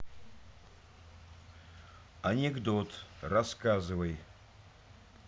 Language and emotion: Russian, neutral